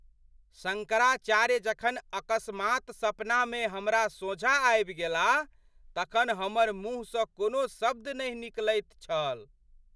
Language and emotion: Maithili, surprised